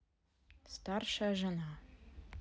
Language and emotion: Russian, neutral